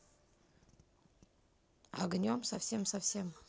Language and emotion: Russian, neutral